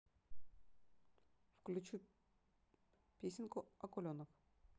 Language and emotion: Russian, neutral